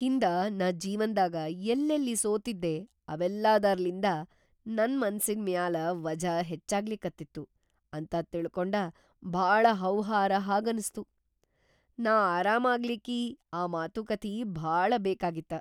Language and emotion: Kannada, surprised